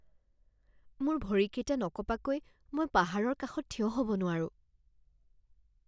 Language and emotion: Assamese, fearful